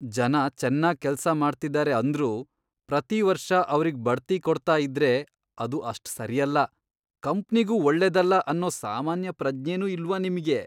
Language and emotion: Kannada, disgusted